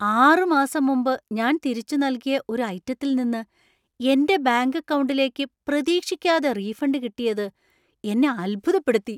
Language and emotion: Malayalam, surprised